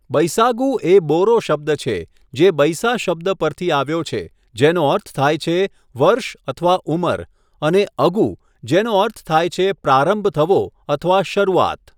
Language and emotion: Gujarati, neutral